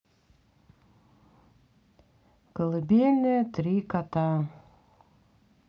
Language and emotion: Russian, sad